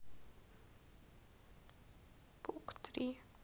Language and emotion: Russian, sad